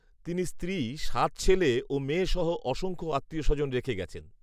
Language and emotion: Bengali, neutral